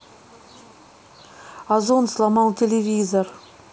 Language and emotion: Russian, neutral